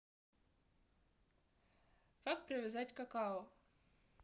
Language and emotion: Russian, neutral